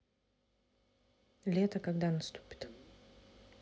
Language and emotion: Russian, neutral